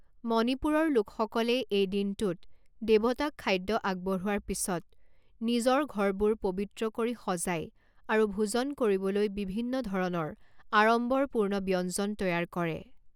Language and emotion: Assamese, neutral